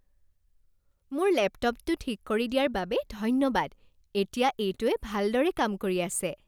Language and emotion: Assamese, happy